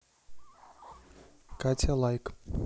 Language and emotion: Russian, neutral